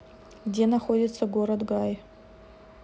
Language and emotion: Russian, neutral